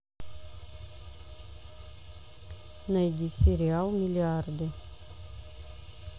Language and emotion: Russian, neutral